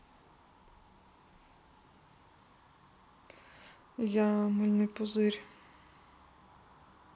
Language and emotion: Russian, neutral